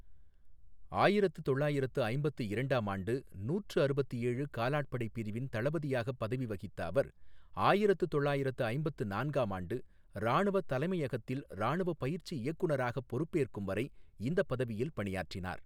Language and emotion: Tamil, neutral